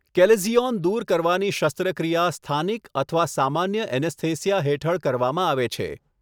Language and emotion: Gujarati, neutral